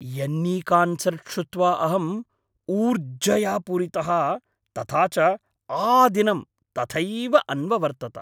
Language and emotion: Sanskrit, happy